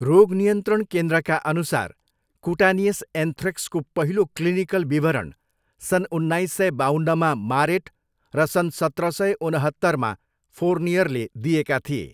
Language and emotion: Nepali, neutral